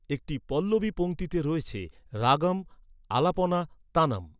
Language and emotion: Bengali, neutral